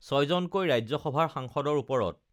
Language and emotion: Assamese, neutral